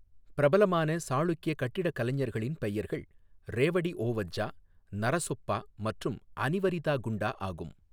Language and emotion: Tamil, neutral